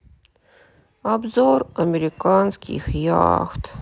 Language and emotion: Russian, sad